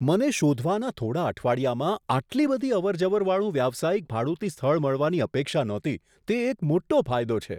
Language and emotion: Gujarati, surprised